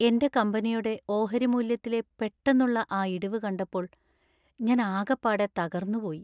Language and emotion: Malayalam, sad